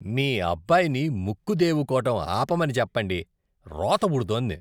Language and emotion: Telugu, disgusted